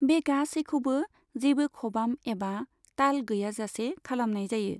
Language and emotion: Bodo, neutral